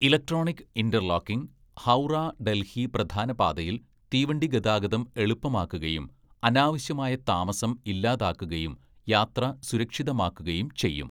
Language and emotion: Malayalam, neutral